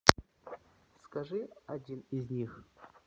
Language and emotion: Russian, neutral